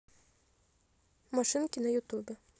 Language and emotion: Russian, neutral